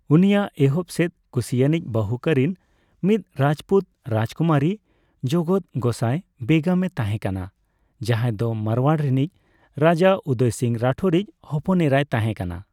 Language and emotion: Santali, neutral